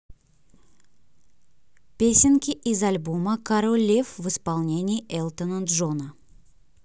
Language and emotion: Russian, neutral